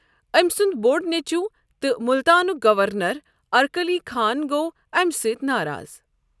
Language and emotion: Kashmiri, neutral